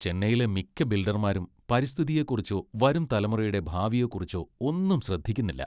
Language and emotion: Malayalam, disgusted